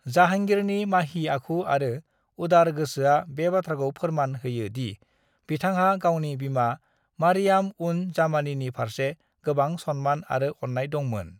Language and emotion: Bodo, neutral